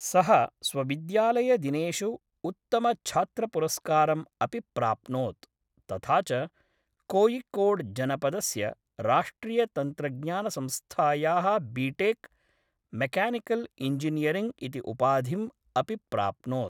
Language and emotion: Sanskrit, neutral